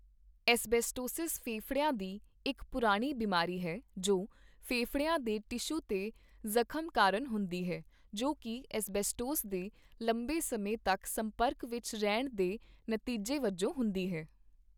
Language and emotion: Punjabi, neutral